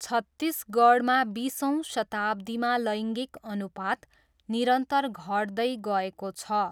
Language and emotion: Nepali, neutral